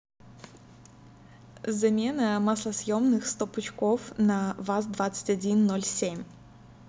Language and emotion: Russian, neutral